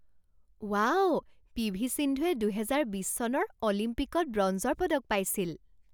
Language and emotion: Assamese, surprised